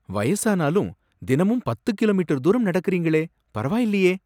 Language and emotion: Tamil, surprised